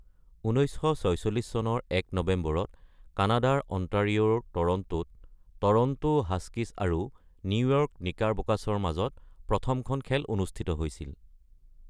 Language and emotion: Assamese, neutral